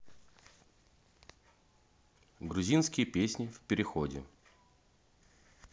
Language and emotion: Russian, neutral